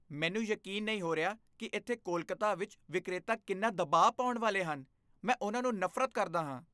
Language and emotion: Punjabi, disgusted